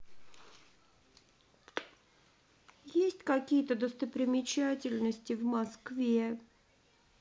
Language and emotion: Russian, sad